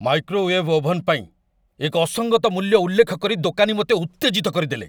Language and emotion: Odia, angry